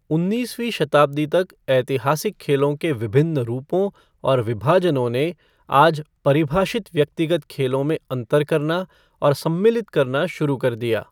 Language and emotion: Hindi, neutral